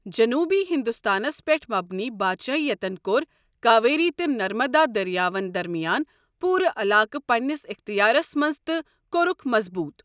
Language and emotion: Kashmiri, neutral